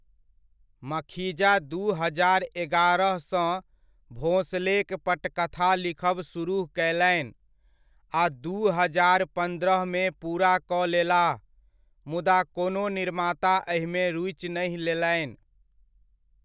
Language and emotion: Maithili, neutral